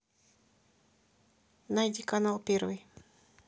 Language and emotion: Russian, neutral